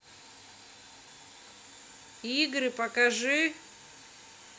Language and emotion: Russian, angry